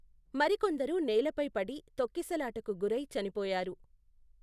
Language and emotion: Telugu, neutral